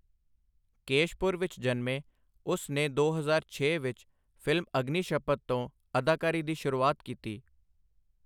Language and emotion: Punjabi, neutral